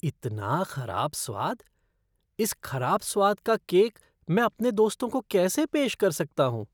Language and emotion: Hindi, disgusted